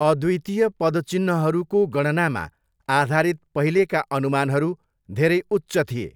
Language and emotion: Nepali, neutral